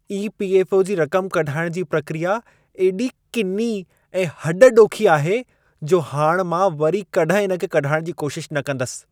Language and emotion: Sindhi, disgusted